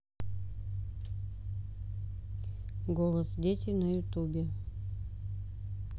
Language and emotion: Russian, neutral